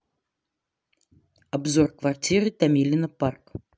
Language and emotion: Russian, neutral